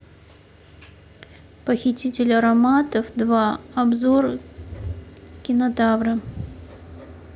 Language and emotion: Russian, neutral